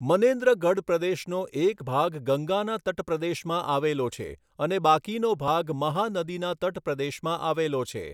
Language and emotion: Gujarati, neutral